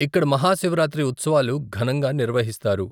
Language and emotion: Telugu, neutral